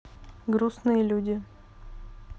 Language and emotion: Russian, neutral